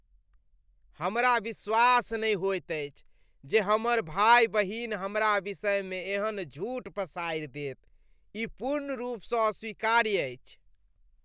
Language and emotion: Maithili, disgusted